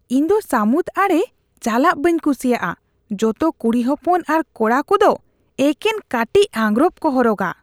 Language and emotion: Santali, disgusted